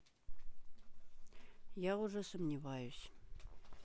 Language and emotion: Russian, neutral